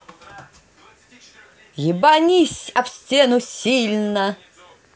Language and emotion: Russian, positive